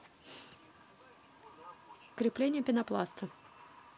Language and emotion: Russian, neutral